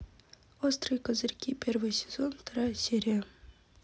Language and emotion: Russian, neutral